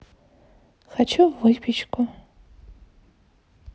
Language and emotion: Russian, neutral